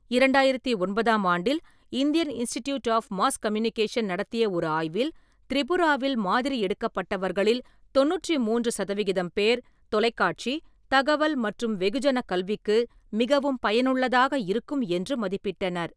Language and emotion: Tamil, neutral